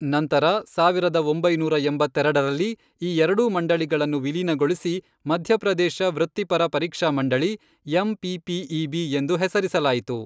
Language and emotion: Kannada, neutral